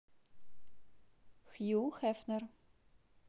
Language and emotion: Russian, neutral